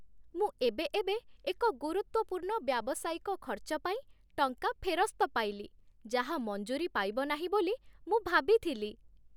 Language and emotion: Odia, happy